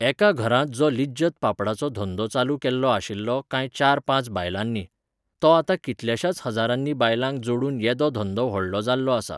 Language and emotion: Goan Konkani, neutral